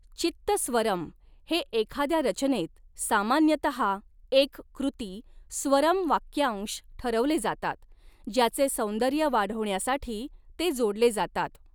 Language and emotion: Marathi, neutral